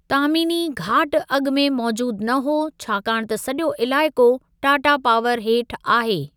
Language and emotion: Sindhi, neutral